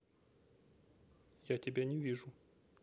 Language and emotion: Russian, neutral